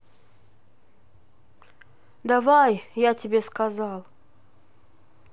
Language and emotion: Russian, neutral